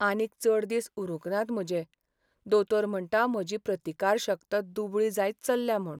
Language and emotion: Goan Konkani, sad